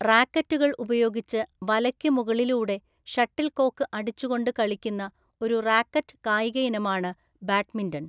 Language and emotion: Malayalam, neutral